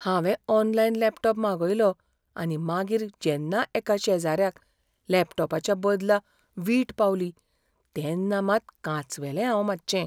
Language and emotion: Goan Konkani, fearful